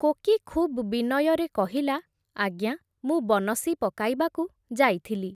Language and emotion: Odia, neutral